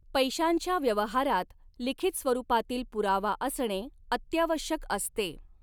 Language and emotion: Marathi, neutral